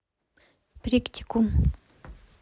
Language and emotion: Russian, neutral